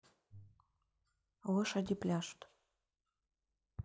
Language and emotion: Russian, neutral